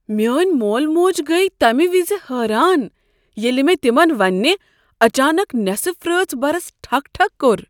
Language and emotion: Kashmiri, surprised